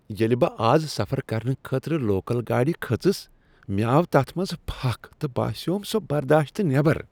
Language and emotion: Kashmiri, disgusted